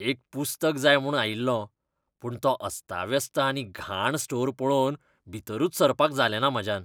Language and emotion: Goan Konkani, disgusted